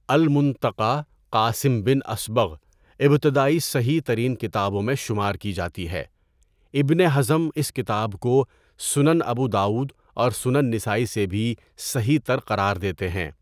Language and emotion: Urdu, neutral